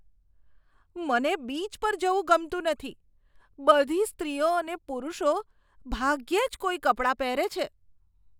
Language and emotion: Gujarati, disgusted